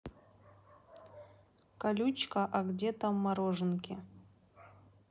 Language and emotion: Russian, neutral